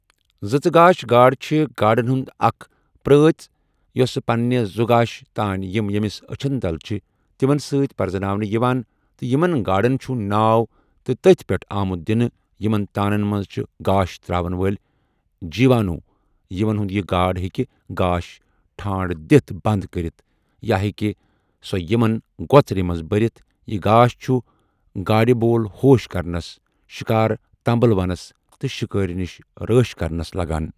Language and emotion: Kashmiri, neutral